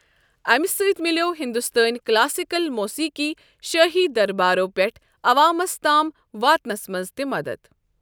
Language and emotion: Kashmiri, neutral